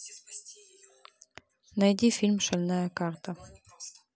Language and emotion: Russian, neutral